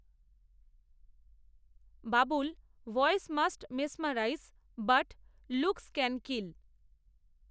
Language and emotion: Bengali, neutral